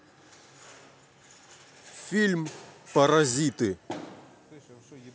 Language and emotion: Russian, neutral